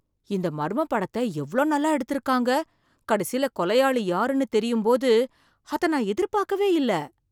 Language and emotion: Tamil, surprised